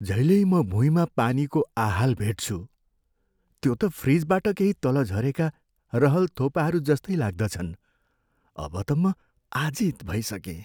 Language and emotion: Nepali, sad